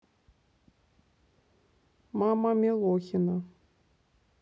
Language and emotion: Russian, neutral